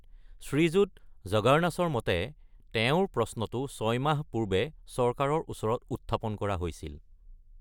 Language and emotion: Assamese, neutral